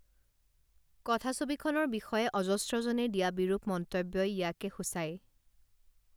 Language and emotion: Assamese, neutral